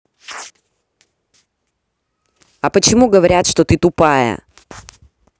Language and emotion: Russian, angry